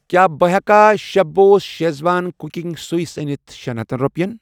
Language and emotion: Kashmiri, neutral